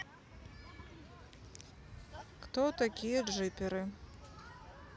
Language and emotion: Russian, neutral